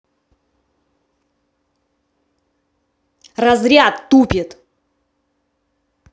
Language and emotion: Russian, angry